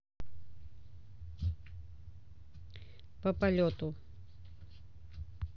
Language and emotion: Russian, neutral